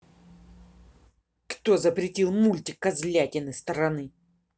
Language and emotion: Russian, angry